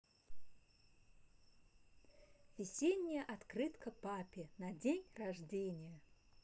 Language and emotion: Russian, positive